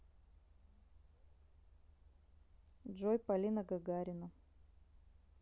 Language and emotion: Russian, neutral